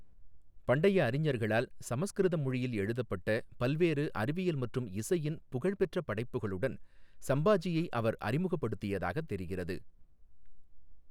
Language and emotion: Tamil, neutral